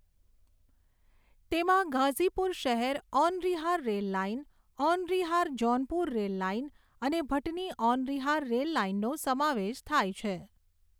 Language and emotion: Gujarati, neutral